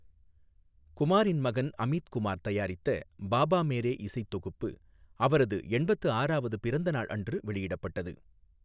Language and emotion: Tamil, neutral